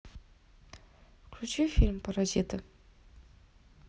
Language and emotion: Russian, neutral